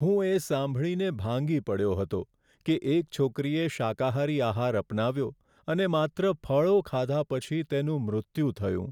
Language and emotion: Gujarati, sad